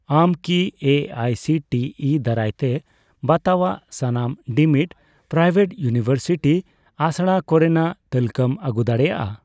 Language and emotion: Santali, neutral